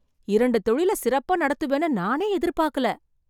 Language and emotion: Tamil, surprised